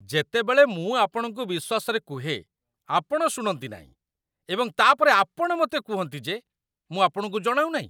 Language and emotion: Odia, disgusted